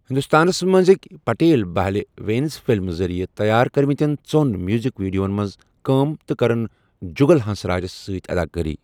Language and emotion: Kashmiri, neutral